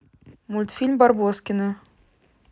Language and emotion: Russian, neutral